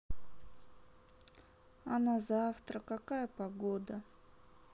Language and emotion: Russian, sad